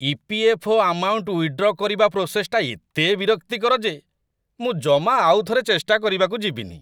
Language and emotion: Odia, disgusted